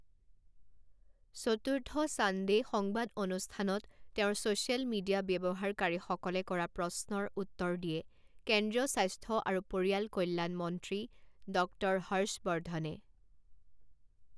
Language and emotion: Assamese, neutral